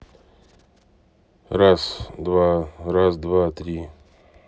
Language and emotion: Russian, neutral